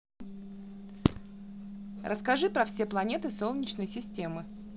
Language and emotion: Russian, neutral